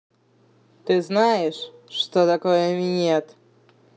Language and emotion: Russian, angry